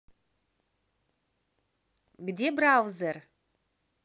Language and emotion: Russian, positive